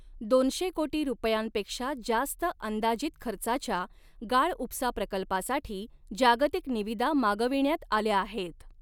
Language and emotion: Marathi, neutral